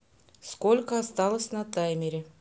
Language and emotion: Russian, neutral